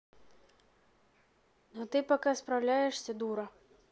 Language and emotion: Russian, neutral